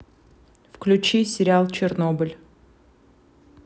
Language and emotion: Russian, neutral